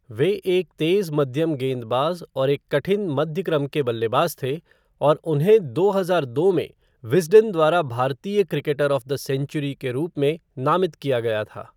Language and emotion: Hindi, neutral